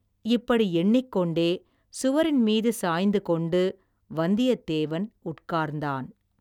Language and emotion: Tamil, neutral